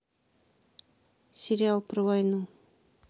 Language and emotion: Russian, neutral